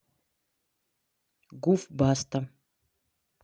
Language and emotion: Russian, neutral